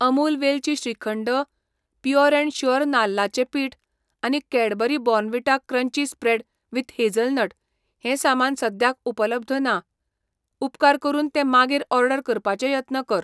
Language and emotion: Goan Konkani, neutral